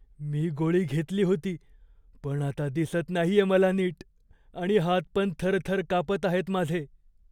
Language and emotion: Marathi, fearful